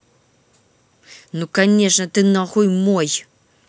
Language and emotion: Russian, angry